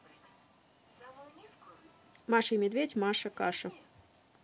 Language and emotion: Russian, neutral